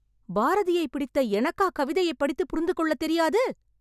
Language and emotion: Tamil, angry